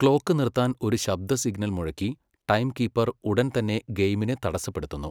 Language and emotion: Malayalam, neutral